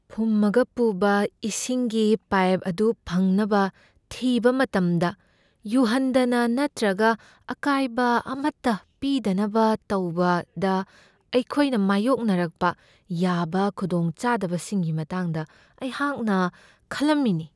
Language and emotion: Manipuri, fearful